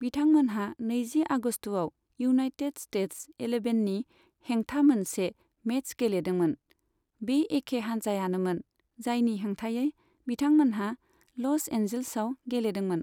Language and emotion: Bodo, neutral